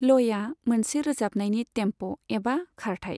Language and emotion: Bodo, neutral